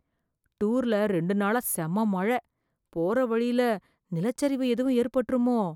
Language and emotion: Tamil, fearful